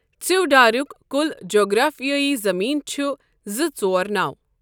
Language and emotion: Kashmiri, neutral